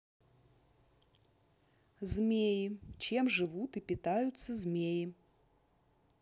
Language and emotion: Russian, neutral